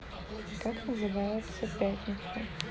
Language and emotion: Russian, neutral